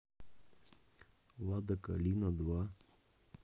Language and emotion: Russian, neutral